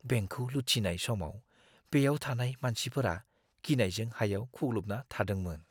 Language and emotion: Bodo, fearful